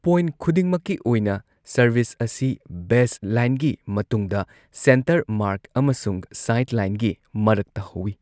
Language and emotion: Manipuri, neutral